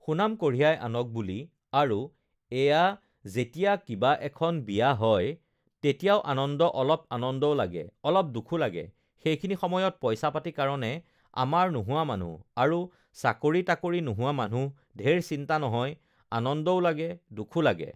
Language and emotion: Assamese, neutral